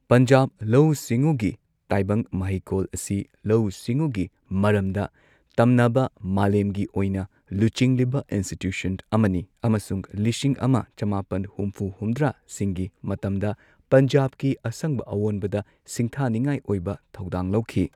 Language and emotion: Manipuri, neutral